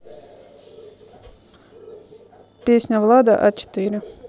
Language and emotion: Russian, neutral